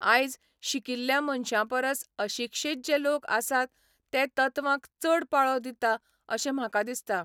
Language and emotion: Goan Konkani, neutral